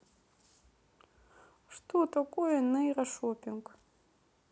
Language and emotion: Russian, neutral